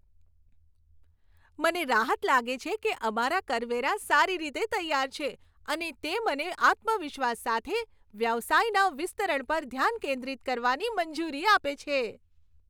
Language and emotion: Gujarati, happy